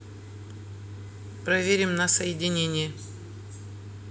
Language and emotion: Russian, neutral